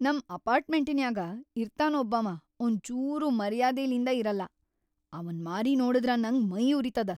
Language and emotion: Kannada, angry